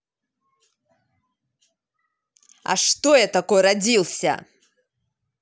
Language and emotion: Russian, angry